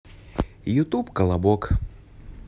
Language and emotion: Russian, positive